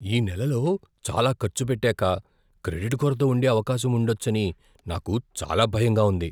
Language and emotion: Telugu, fearful